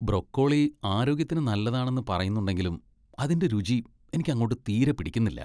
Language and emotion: Malayalam, disgusted